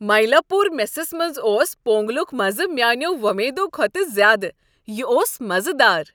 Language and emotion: Kashmiri, happy